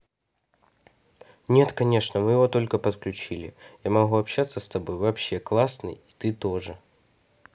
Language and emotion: Russian, neutral